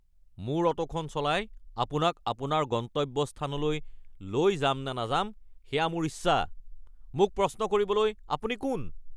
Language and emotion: Assamese, angry